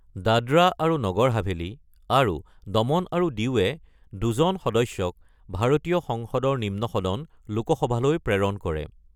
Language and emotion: Assamese, neutral